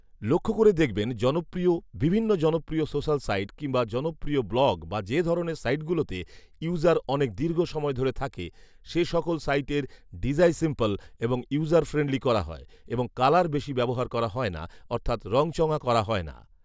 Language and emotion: Bengali, neutral